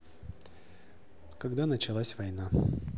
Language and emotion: Russian, neutral